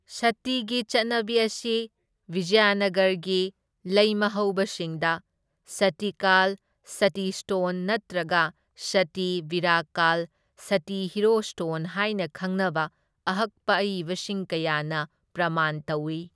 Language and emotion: Manipuri, neutral